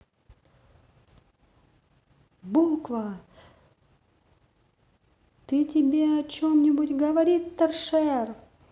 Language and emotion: Russian, positive